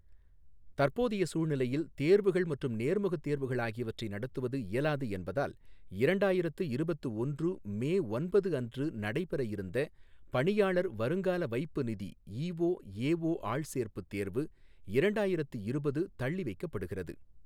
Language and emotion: Tamil, neutral